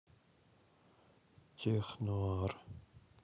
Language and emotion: Russian, sad